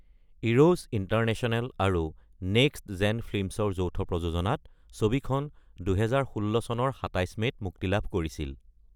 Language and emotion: Assamese, neutral